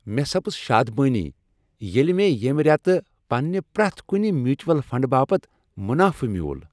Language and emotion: Kashmiri, happy